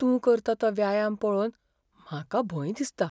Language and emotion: Goan Konkani, fearful